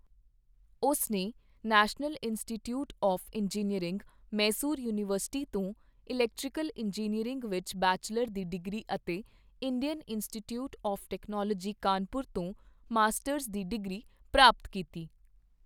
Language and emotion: Punjabi, neutral